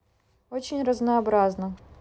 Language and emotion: Russian, neutral